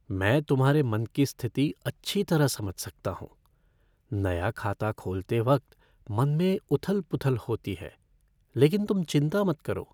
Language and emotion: Hindi, fearful